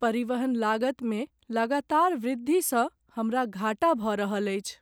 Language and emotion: Maithili, sad